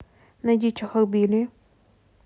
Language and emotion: Russian, neutral